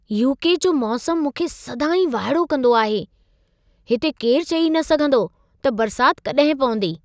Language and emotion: Sindhi, surprised